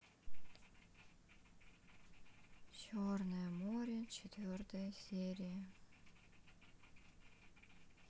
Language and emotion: Russian, sad